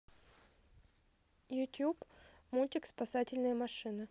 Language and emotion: Russian, neutral